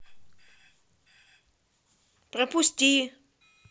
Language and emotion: Russian, angry